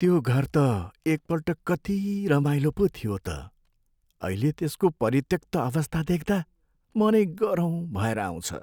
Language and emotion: Nepali, sad